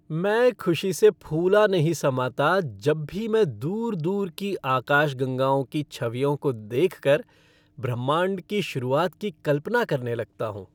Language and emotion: Hindi, happy